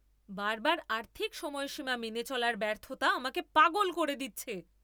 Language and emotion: Bengali, angry